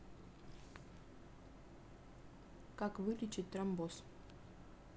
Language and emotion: Russian, neutral